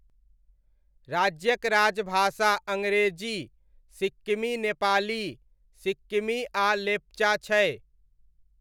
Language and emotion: Maithili, neutral